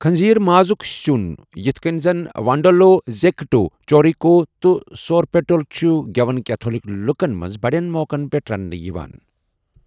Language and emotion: Kashmiri, neutral